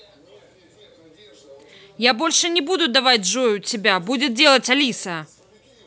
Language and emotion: Russian, angry